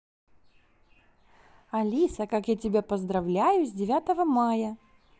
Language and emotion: Russian, positive